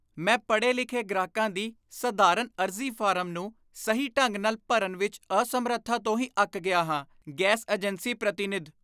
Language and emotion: Punjabi, disgusted